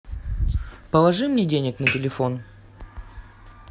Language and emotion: Russian, neutral